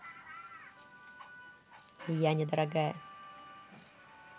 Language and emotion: Russian, positive